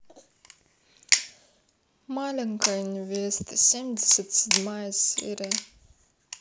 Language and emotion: Russian, sad